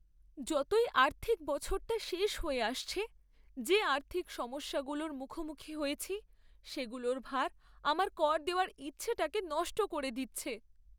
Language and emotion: Bengali, sad